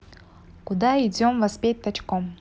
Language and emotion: Russian, neutral